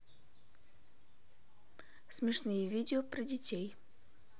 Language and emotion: Russian, neutral